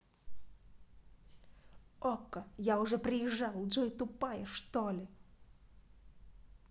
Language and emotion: Russian, angry